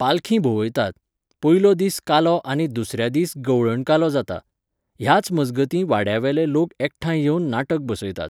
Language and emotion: Goan Konkani, neutral